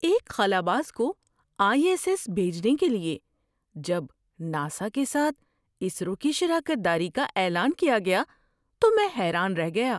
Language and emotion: Urdu, surprised